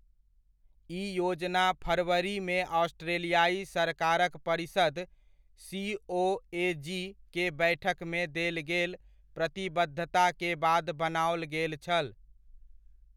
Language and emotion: Maithili, neutral